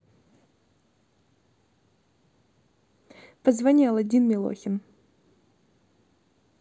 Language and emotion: Russian, neutral